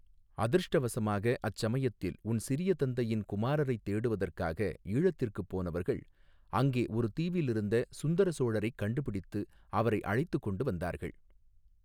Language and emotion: Tamil, neutral